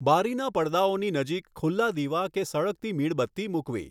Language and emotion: Gujarati, neutral